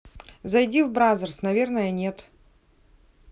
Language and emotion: Russian, neutral